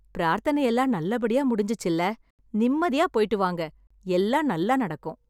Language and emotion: Tamil, happy